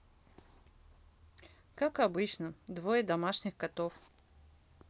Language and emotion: Russian, neutral